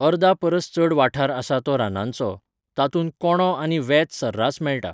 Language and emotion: Goan Konkani, neutral